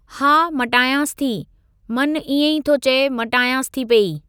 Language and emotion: Sindhi, neutral